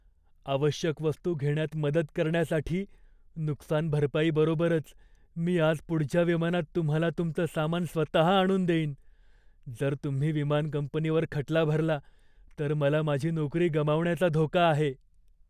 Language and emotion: Marathi, fearful